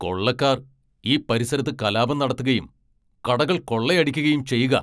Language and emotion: Malayalam, angry